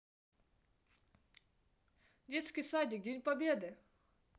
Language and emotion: Russian, positive